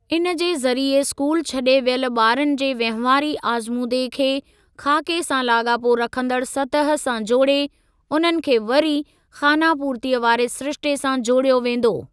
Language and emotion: Sindhi, neutral